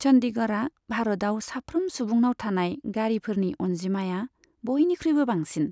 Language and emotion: Bodo, neutral